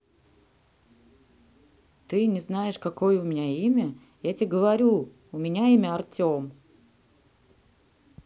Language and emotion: Russian, neutral